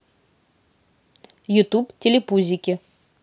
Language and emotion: Russian, positive